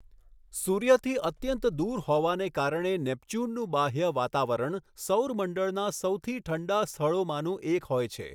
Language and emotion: Gujarati, neutral